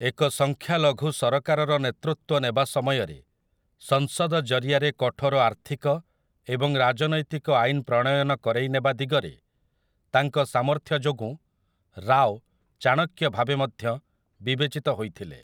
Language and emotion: Odia, neutral